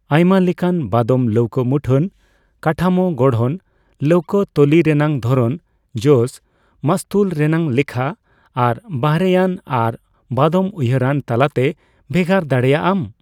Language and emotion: Santali, neutral